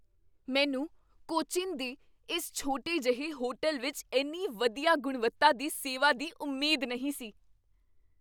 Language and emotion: Punjabi, surprised